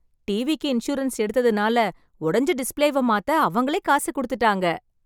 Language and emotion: Tamil, happy